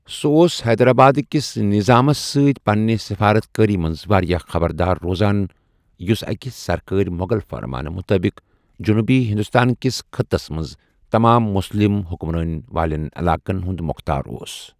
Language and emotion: Kashmiri, neutral